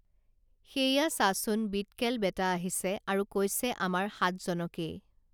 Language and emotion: Assamese, neutral